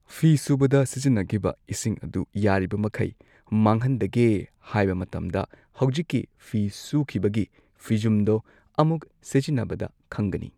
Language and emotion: Manipuri, neutral